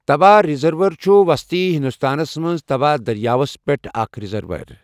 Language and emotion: Kashmiri, neutral